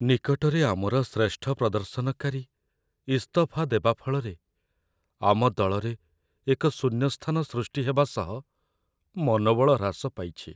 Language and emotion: Odia, sad